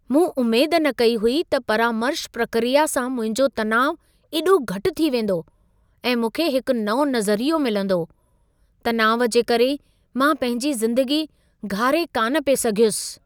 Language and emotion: Sindhi, surprised